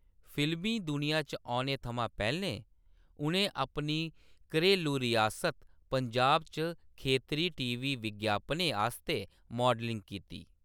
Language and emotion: Dogri, neutral